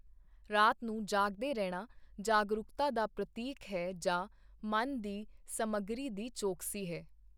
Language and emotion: Punjabi, neutral